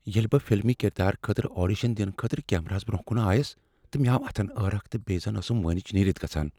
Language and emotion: Kashmiri, fearful